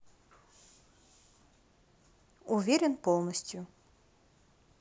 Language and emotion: Russian, neutral